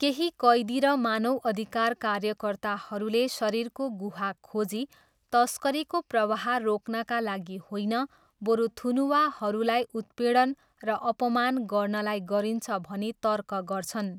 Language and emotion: Nepali, neutral